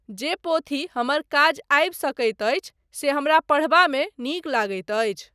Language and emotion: Maithili, neutral